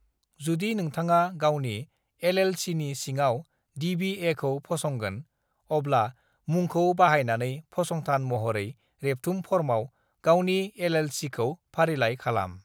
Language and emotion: Bodo, neutral